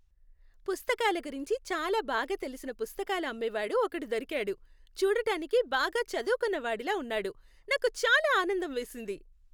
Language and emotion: Telugu, happy